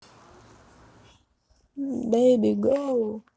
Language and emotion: Russian, neutral